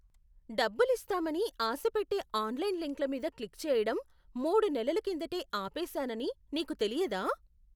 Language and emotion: Telugu, surprised